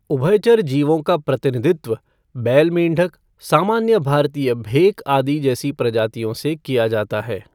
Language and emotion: Hindi, neutral